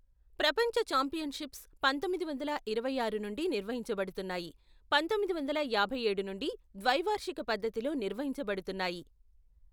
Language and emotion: Telugu, neutral